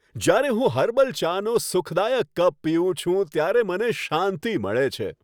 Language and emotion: Gujarati, happy